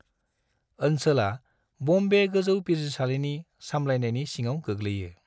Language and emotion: Bodo, neutral